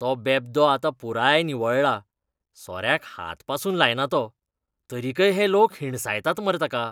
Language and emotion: Goan Konkani, disgusted